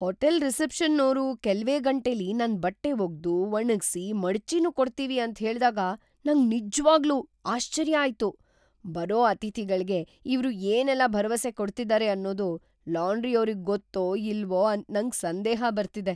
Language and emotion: Kannada, surprised